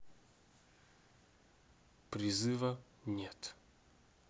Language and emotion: Russian, neutral